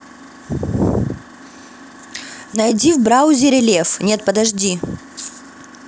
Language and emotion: Russian, neutral